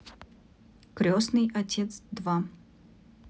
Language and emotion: Russian, neutral